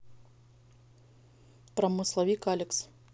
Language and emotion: Russian, neutral